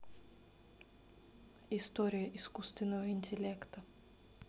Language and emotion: Russian, neutral